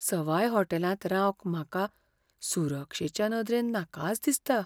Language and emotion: Goan Konkani, fearful